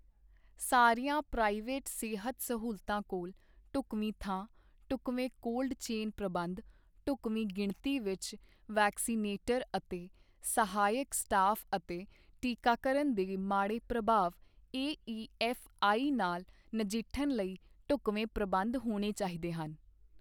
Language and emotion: Punjabi, neutral